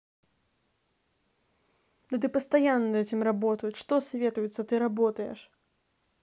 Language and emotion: Russian, angry